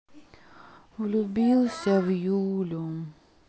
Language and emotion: Russian, sad